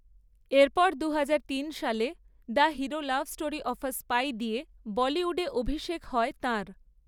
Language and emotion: Bengali, neutral